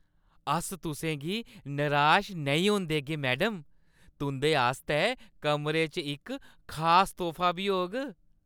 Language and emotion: Dogri, happy